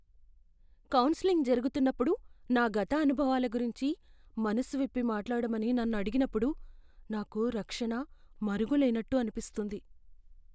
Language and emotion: Telugu, fearful